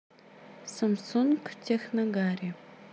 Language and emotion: Russian, neutral